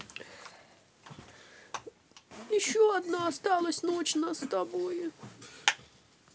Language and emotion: Russian, sad